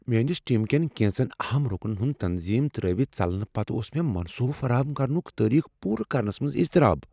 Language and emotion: Kashmiri, fearful